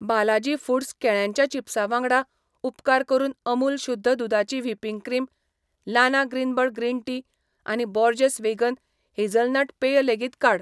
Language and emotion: Goan Konkani, neutral